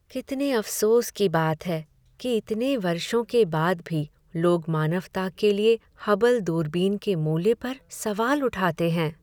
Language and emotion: Hindi, sad